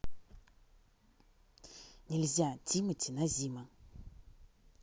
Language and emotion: Russian, neutral